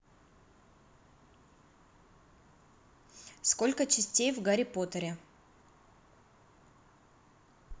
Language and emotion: Russian, neutral